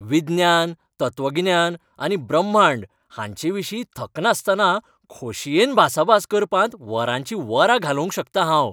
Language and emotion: Goan Konkani, happy